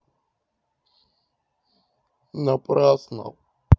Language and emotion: Russian, sad